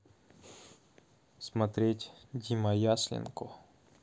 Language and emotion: Russian, neutral